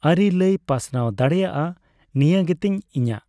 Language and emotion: Santali, neutral